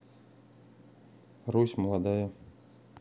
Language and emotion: Russian, neutral